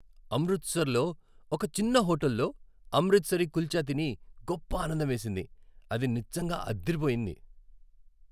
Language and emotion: Telugu, happy